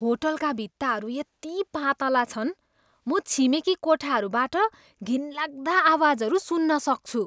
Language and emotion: Nepali, disgusted